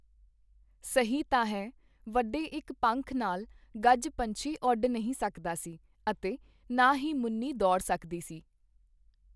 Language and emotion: Punjabi, neutral